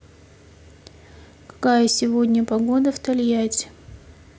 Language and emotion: Russian, neutral